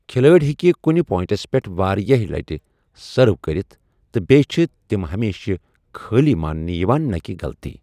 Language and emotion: Kashmiri, neutral